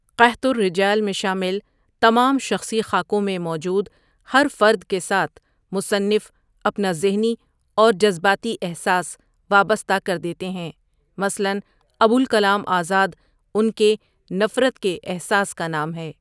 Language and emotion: Urdu, neutral